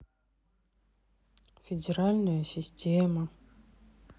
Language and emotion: Russian, sad